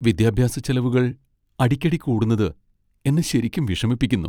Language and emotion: Malayalam, sad